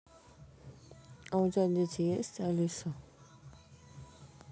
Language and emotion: Russian, neutral